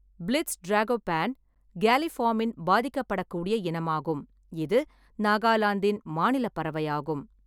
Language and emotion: Tamil, neutral